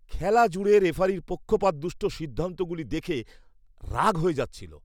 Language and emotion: Bengali, disgusted